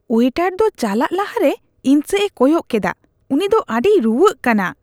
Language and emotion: Santali, disgusted